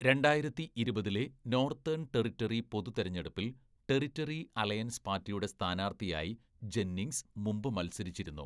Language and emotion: Malayalam, neutral